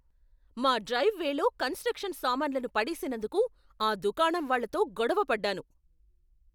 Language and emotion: Telugu, angry